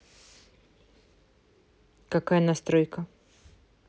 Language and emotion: Russian, neutral